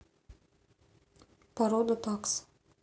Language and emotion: Russian, neutral